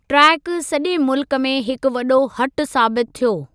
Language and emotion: Sindhi, neutral